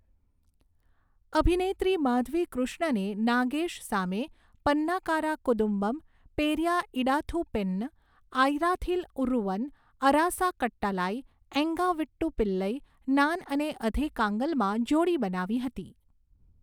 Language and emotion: Gujarati, neutral